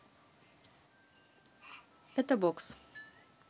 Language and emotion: Russian, neutral